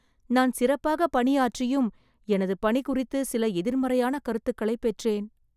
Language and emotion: Tamil, sad